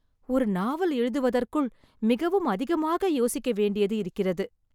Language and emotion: Tamil, sad